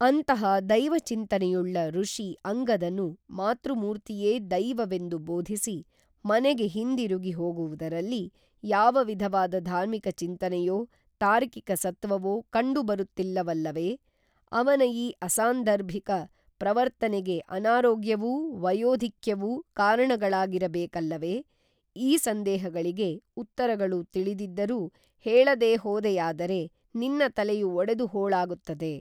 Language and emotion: Kannada, neutral